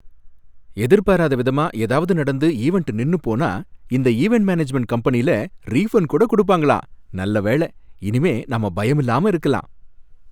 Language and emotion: Tamil, happy